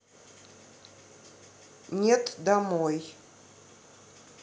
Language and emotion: Russian, neutral